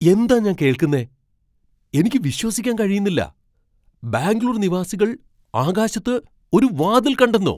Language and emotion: Malayalam, surprised